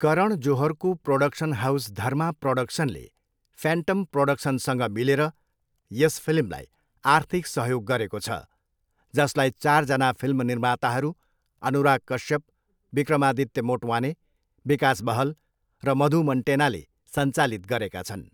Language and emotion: Nepali, neutral